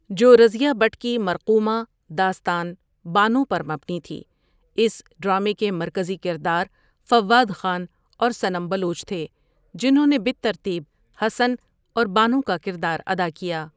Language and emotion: Urdu, neutral